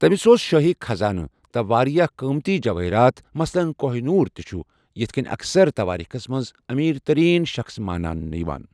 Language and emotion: Kashmiri, neutral